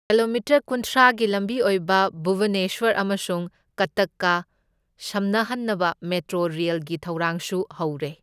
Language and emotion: Manipuri, neutral